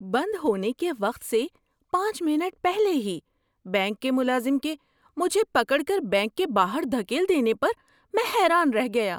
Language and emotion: Urdu, surprised